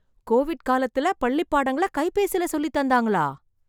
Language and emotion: Tamil, surprised